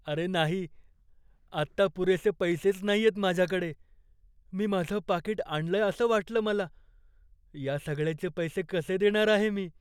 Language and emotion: Marathi, fearful